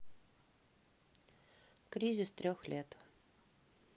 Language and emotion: Russian, neutral